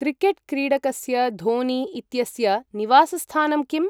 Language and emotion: Sanskrit, neutral